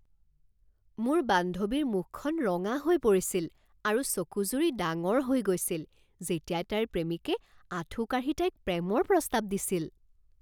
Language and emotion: Assamese, surprised